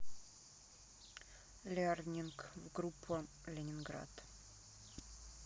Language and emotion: Russian, neutral